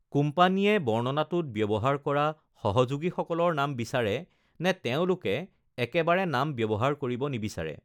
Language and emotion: Assamese, neutral